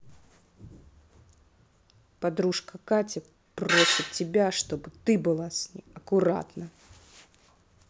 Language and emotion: Russian, angry